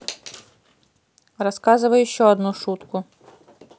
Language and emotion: Russian, angry